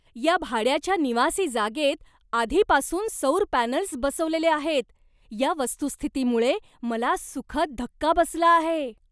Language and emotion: Marathi, surprised